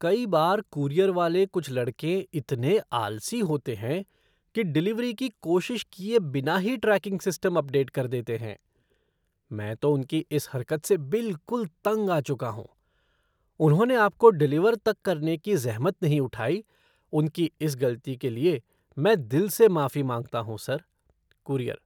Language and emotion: Hindi, disgusted